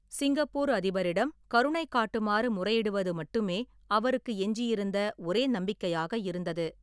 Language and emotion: Tamil, neutral